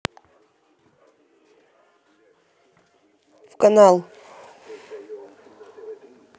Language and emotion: Russian, neutral